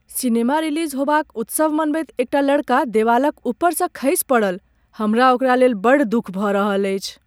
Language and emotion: Maithili, sad